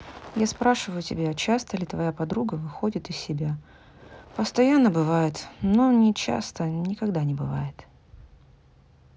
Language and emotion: Russian, neutral